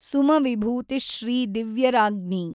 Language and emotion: Kannada, neutral